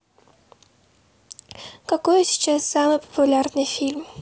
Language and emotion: Russian, neutral